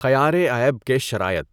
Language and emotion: Urdu, neutral